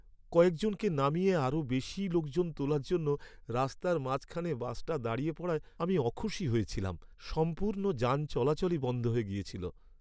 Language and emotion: Bengali, sad